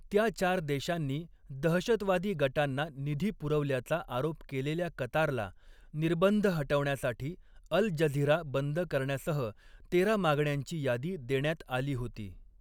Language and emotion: Marathi, neutral